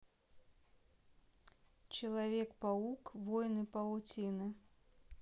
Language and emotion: Russian, neutral